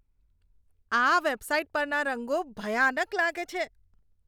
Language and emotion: Gujarati, disgusted